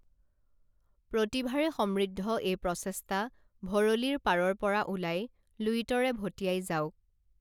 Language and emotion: Assamese, neutral